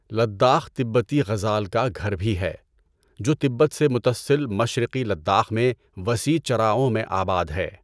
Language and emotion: Urdu, neutral